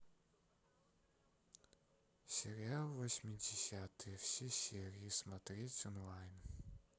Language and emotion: Russian, sad